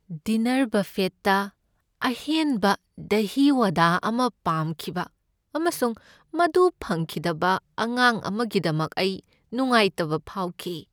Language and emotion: Manipuri, sad